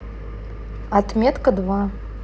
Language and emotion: Russian, neutral